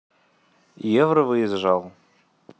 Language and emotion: Russian, neutral